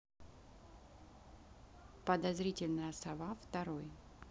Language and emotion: Russian, neutral